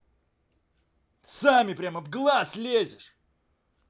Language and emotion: Russian, angry